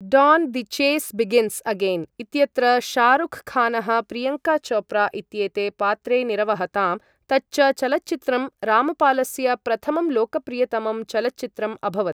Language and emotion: Sanskrit, neutral